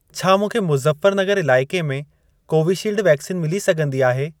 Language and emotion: Sindhi, neutral